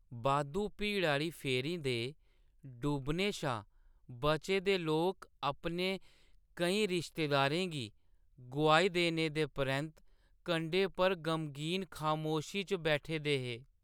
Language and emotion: Dogri, sad